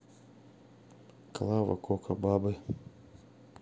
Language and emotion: Russian, neutral